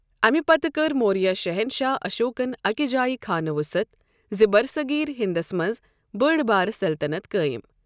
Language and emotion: Kashmiri, neutral